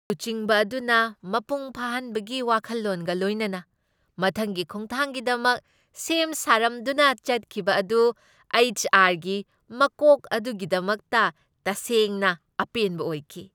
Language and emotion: Manipuri, happy